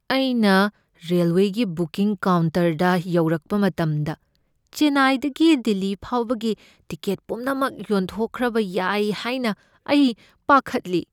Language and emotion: Manipuri, fearful